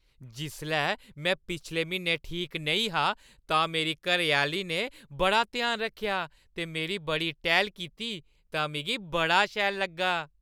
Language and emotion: Dogri, happy